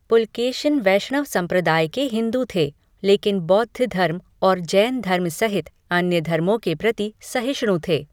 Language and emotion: Hindi, neutral